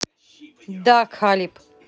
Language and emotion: Russian, neutral